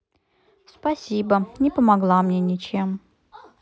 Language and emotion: Russian, sad